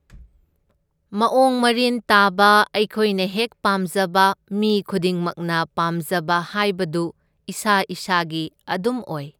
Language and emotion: Manipuri, neutral